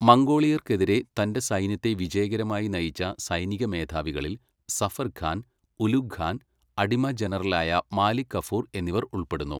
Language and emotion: Malayalam, neutral